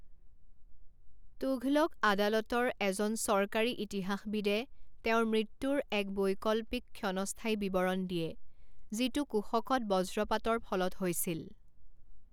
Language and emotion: Assamese, neutral